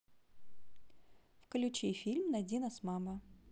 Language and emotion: Russian, neutral